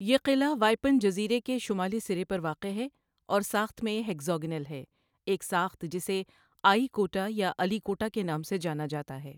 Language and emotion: Urdu, neutral